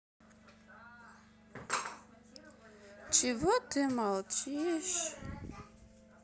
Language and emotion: Russian, sad